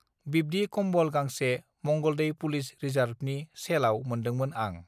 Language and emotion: Bodo, neutral